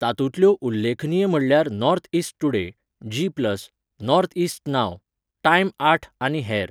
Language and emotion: Goan Konkani, neutral